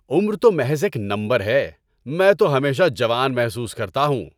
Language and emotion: Urdu, happy